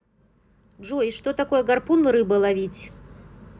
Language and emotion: Russian, neutral